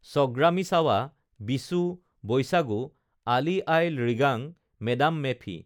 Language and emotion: Assamese, neutral